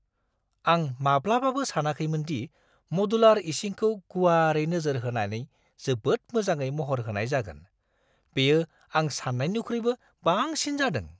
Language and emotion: Bodo, surprised